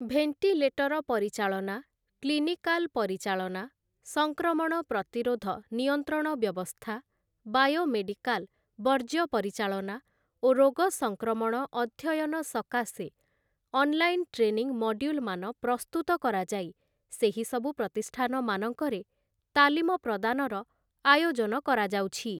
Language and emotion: Odia, neutral